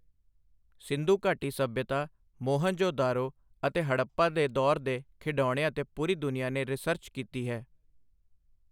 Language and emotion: Punjabi, neutral